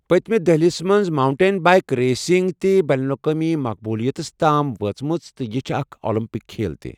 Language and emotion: Kashmiri, neutral